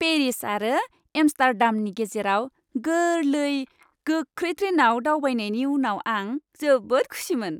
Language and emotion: Bodo, happy